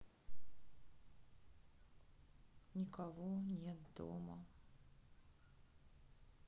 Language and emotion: Russian, sad